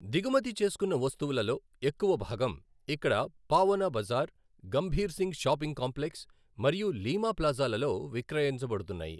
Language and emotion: Telugu, neutral